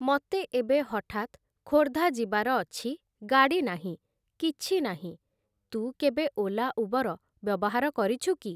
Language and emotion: Odia, neutral